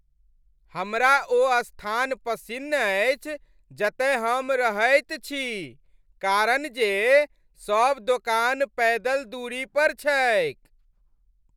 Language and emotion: Maithili, happy